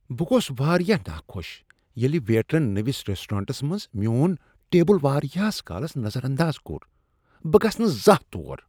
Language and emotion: Kashmiri, disgusted